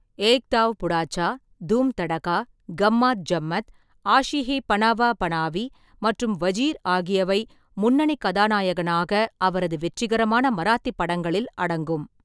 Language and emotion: Tamil, neutral